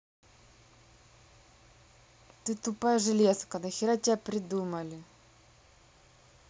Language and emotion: Russian, angry